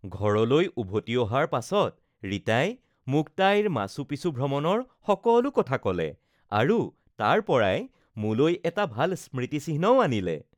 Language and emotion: Assamese, happy